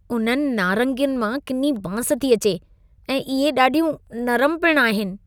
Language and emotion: Sindhi, disgusted